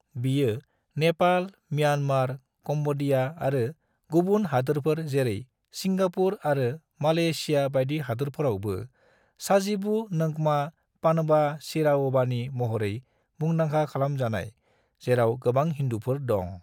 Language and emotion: Bodo, neutral